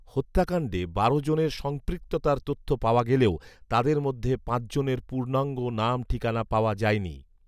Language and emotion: Bengali, neutral